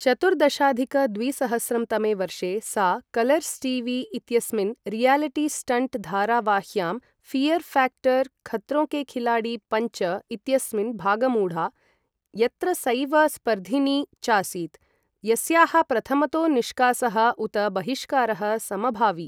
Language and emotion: Sanskrit, neutral